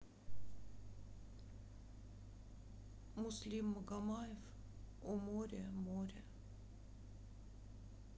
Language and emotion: Russian, sad